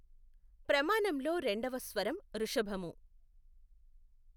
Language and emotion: Telugu, neutral